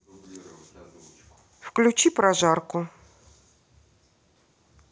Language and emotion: Russian, neutral